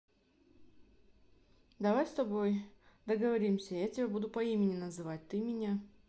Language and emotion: Russian, neutral